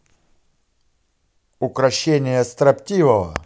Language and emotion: Russian, positive